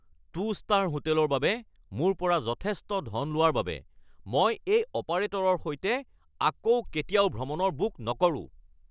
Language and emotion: Assamese, angry